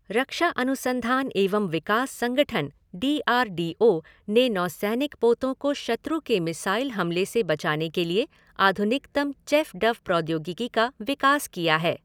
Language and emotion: Hindi, neutral